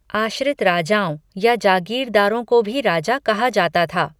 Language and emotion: Hindi, neutral